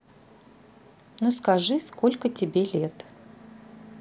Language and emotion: Russian, neutral